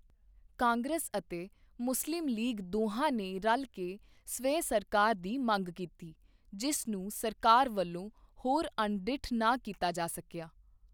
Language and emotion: Punjabi, neutral